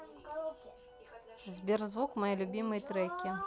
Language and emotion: Russian, neutral